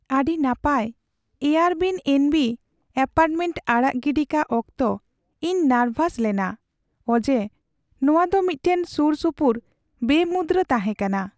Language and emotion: Santali, sad